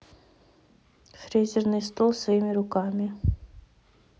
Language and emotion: Russian, neutral